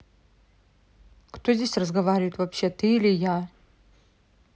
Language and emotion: Russian, angry